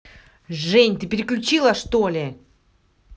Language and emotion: Russian, angry